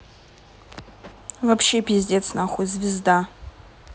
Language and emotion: Russian, angry